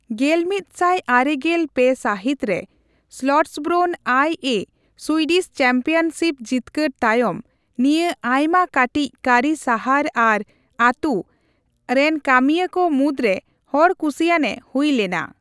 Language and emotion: Santali, neutral